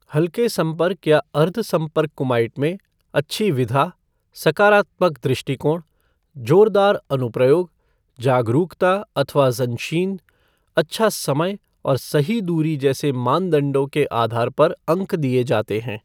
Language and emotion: Hindi, neutral